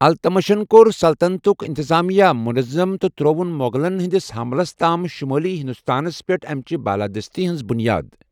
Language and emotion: Kashmiri, neutral